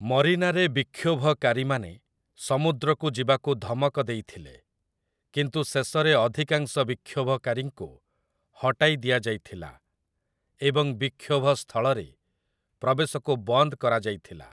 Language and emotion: Odia, neutral